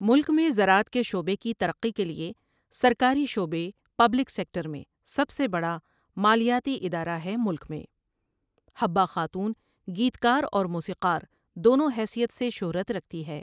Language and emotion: Urdu, neutral